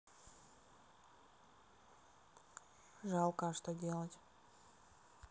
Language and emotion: Russian, neutral